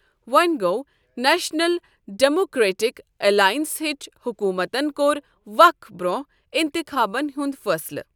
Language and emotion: Kashmiri, neutral